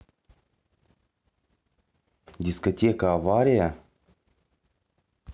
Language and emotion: Russian, neutral